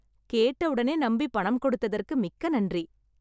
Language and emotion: Tamil, happy